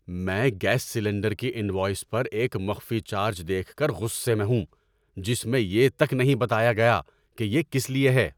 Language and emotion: Urdu, angry